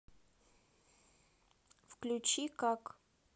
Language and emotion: Russian, neutral